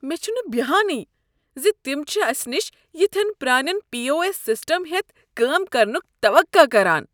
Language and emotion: Kashmiri, disgusted